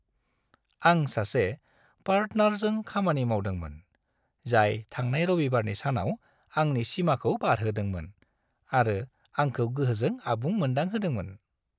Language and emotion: Bodo, happy